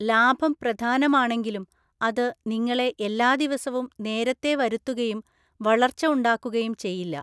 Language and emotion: Malayalam, neutral